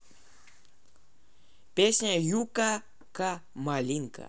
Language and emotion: Russian, neutral